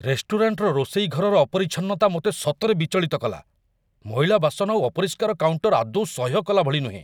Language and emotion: Odia, angry